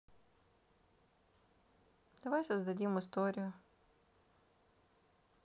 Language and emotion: Russian, sad